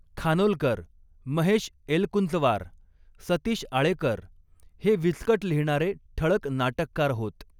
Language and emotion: Marathi, neutral